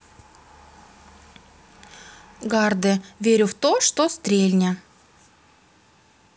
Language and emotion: Russian, neutral